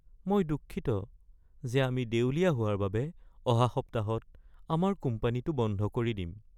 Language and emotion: Assamese, sad